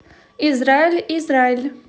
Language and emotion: Russian, positive